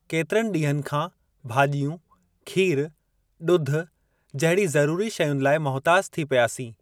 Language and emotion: Sindhi, neutral